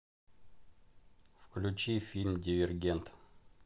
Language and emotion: Russian, neutral